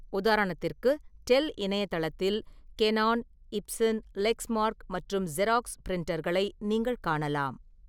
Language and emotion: Tamil, neutral